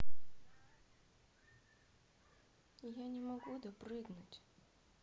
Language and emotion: Russian, sad